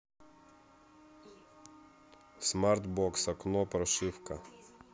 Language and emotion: Russian, neutral